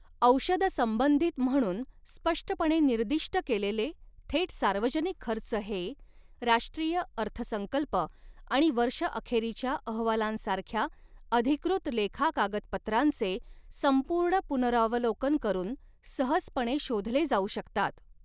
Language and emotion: Marathi, neutral